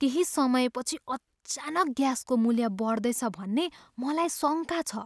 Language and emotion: Nepali, fearful